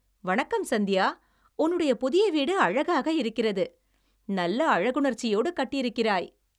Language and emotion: Tamil, happy